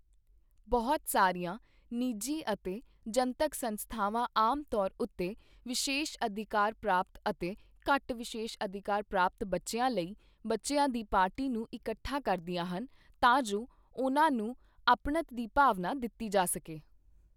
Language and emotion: Punjabi, neutral